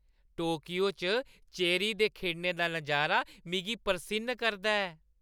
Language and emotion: Dogri, happy